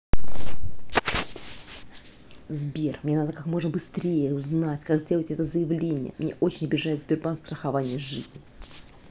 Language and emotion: Russian, angry